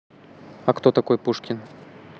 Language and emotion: Russian, neutral